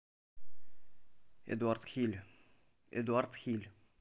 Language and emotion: Russian, neutral